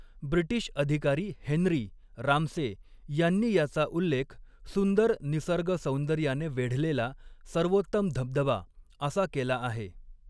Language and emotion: Marathi, neutral